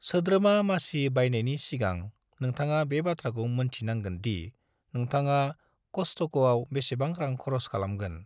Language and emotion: Bodo, neutral